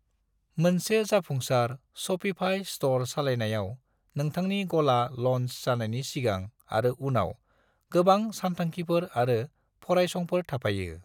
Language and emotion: Bodo, neutral